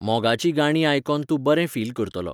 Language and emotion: Goan Konkani, neutral